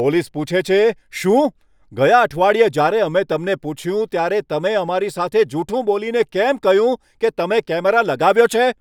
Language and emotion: Gujarati, angry